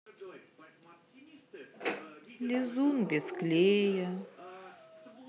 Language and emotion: Russian, sad